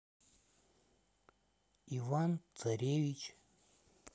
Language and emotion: Russian, neutral